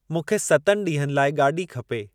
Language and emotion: Sindhi, neutral